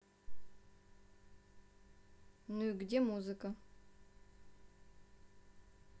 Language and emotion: Russian, neutral